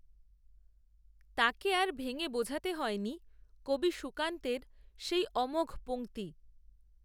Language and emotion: Bengali, neutral